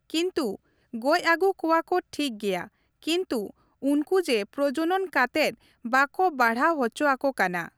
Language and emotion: Santali, neutral